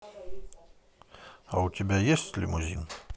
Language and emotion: Russian, neutral